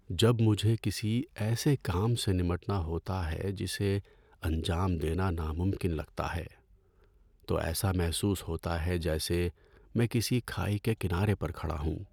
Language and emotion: Urdu, sad